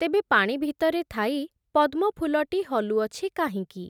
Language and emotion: Odia, neutral